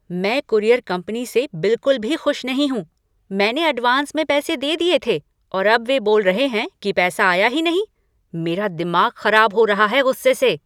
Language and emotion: Hindi, angry